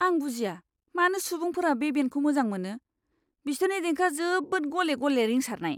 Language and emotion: Bodo, disgusted